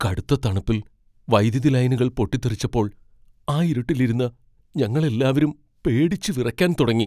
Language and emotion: Malayalam, fearful